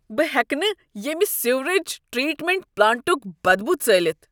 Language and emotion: Kashmiri, disgusted